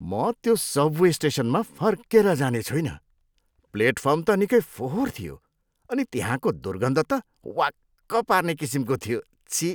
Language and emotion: Nepali, disgusted